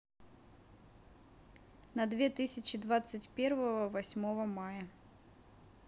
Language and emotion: Russian, neutral